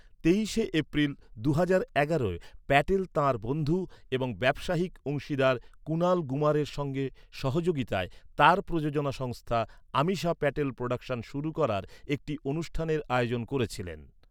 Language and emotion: Bengali, neutral